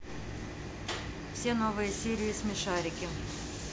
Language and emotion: Russian, neutral